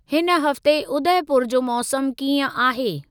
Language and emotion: Sindhi, neutral